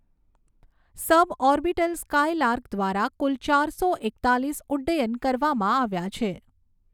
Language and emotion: Gujarati, neutral